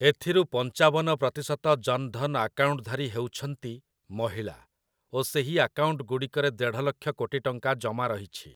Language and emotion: Odia, neutral